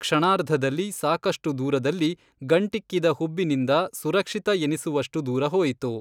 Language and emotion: Kannada, neutral